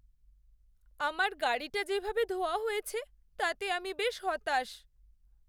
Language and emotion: Bengali, sad